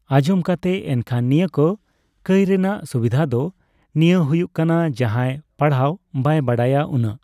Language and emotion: Santali, neutral